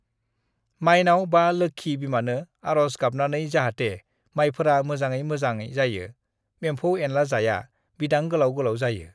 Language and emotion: Bodo, neutral